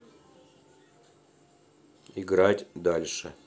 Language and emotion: Russian, neutral